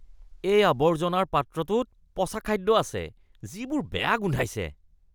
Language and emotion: Assamese, disgusted